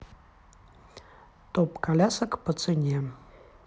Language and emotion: Russian, neutral